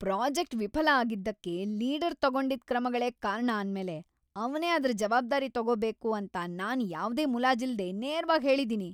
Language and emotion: Kannada, angry